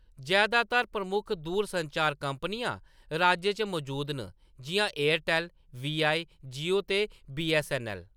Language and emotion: Dogri, neutral